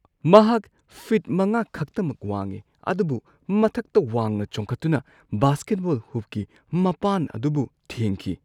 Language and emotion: Manipuri, surprised